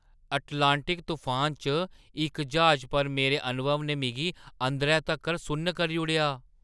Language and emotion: Dogri, surprised